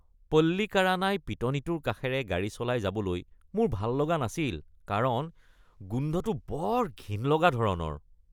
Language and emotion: Assamese, disgusted